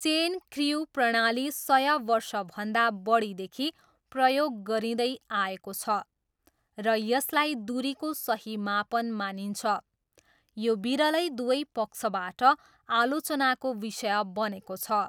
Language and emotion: Nepali, neutral